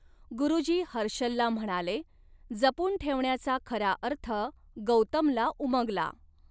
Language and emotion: Marathi, neutral